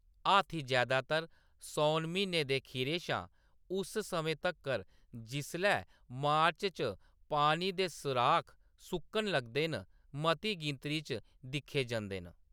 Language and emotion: Dogri, neutral